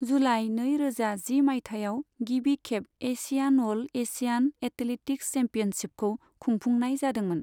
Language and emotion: Bodo, neutral